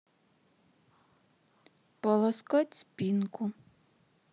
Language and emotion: Russian, sad